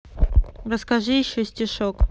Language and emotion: Russian, neutral